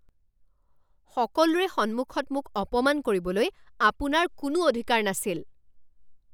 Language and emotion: Assamese, angry